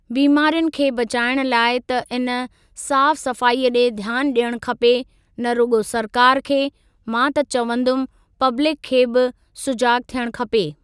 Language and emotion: Sindhi, neutral